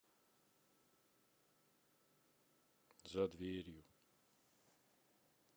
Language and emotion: Russian, sad